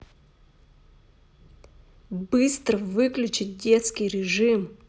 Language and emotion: Russian, angry